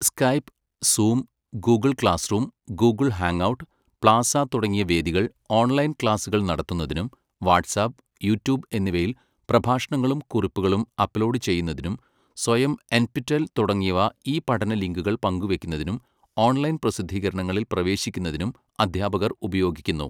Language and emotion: Malayalam, neutral